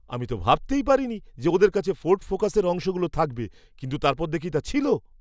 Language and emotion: Bengali, surprised